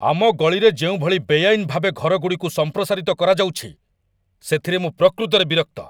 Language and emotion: Odia, angry